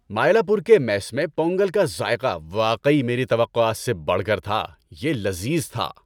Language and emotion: Urdu, happy